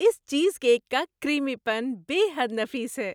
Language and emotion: Urdu, happy